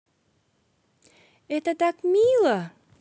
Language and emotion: Russian, positive